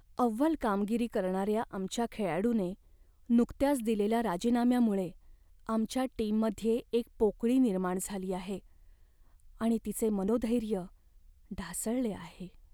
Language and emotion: Marathi, sad